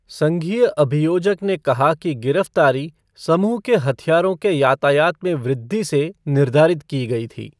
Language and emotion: Hindi, neutral